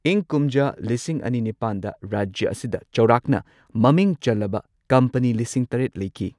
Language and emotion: Manipuri, neutral